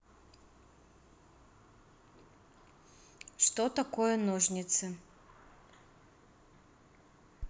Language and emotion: Russian, neutral